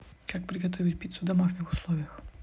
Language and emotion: Russian, neutral